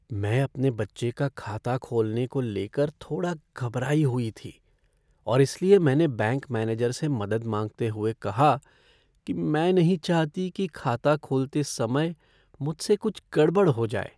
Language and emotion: Hindi, fearful